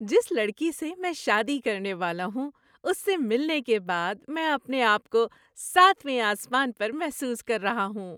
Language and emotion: Urdu, happy